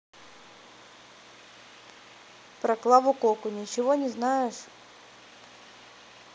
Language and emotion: Russian, neutral